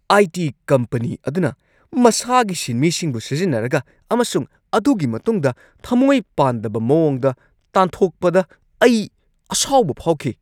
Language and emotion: Manipuri, angry